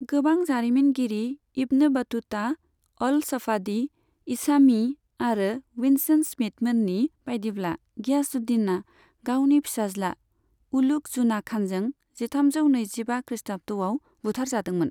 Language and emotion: Bodo, neutral